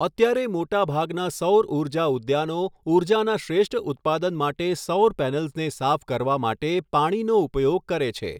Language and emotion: Gujarati, neutral